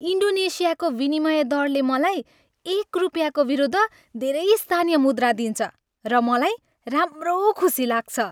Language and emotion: Nepali, happy